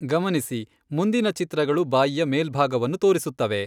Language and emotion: Kannada, neutral